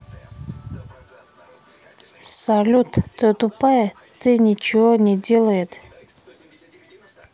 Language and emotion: Russian, neutral